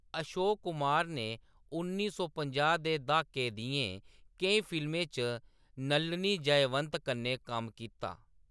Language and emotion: Dogri, neutral